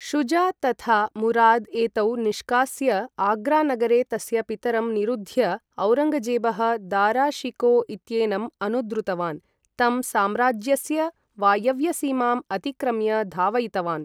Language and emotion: Sanskrit, neutral